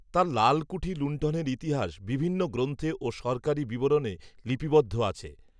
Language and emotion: Bengali, neutral